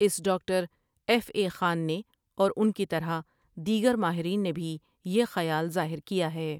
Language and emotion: Urdu, neutral